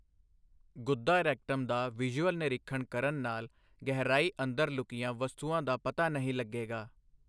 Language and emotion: Punjabi, neutral